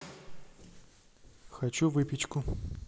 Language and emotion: Russian, neutral